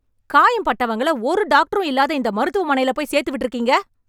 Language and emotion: Tamil, angry